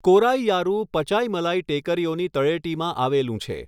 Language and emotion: Gujarati, neutral